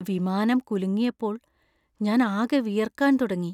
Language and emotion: Malayalam, fearful